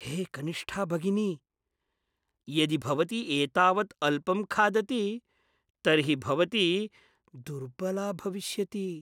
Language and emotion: Sanskrit, fearful